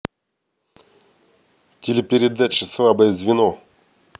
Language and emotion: Russian, neutral